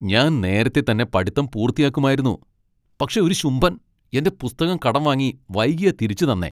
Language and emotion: Malayalam, angry